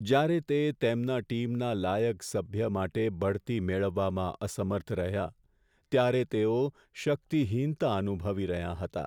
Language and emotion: Gujarati, sad